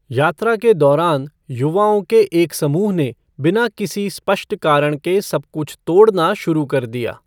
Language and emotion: Hindi, neutral